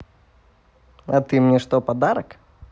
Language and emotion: Russian, positive